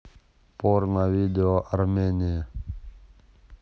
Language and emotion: Russian, neutral